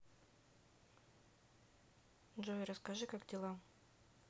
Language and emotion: Russian, neutral